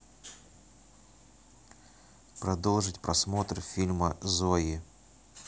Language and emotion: Russian, neutral